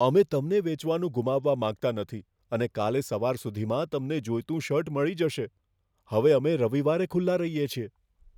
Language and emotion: Gujarati, fearful